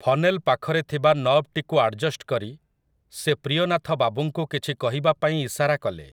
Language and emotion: Odia, neutral